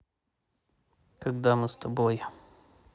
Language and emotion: Russian, neutral